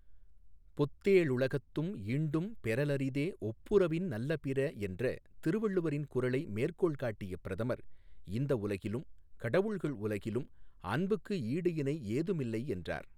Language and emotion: Tamil, neutral